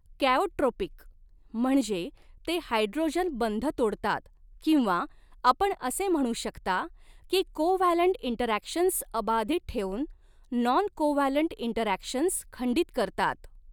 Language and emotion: Marathi, neutral